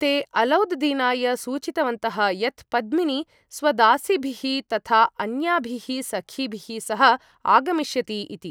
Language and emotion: Sanskrit, neutral